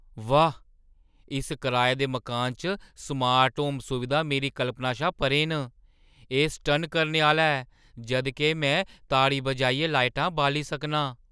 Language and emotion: Dogri, surprised